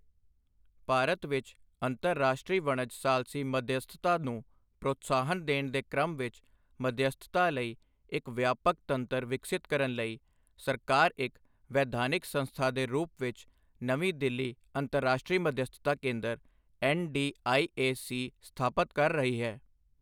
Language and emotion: Punjabi, neutral